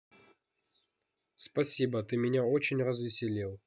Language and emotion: Russian, neutral